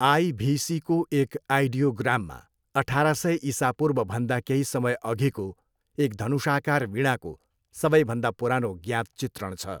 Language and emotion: Nepali, neutral